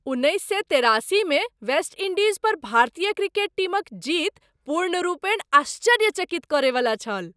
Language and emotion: Maithili, surprised